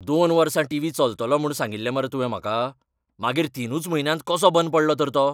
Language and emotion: Goan Konkani, angry